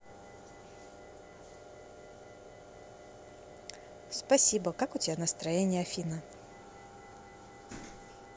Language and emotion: Russian, neutral